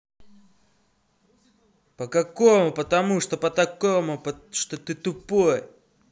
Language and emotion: Russian, angry